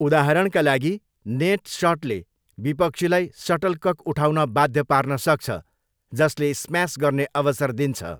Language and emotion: Nepali, neutral